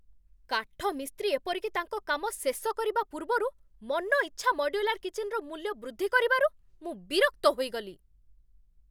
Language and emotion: Odia, angry